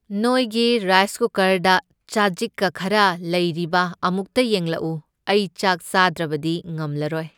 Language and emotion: Manipuri, neutral